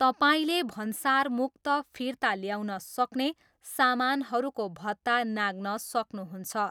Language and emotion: Nepali, neutral